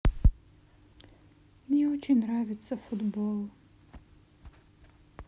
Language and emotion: Russian, sad